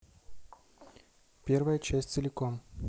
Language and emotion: Russian, neutral